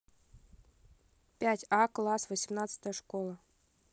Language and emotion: Russian, neutral